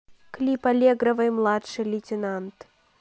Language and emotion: Russian, neutral